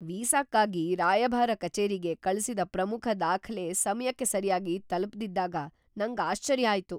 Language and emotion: Kannada, surprised